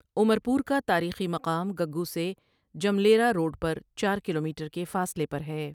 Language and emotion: Urdu, neutral